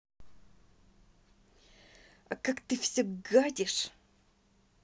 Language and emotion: Russian, angry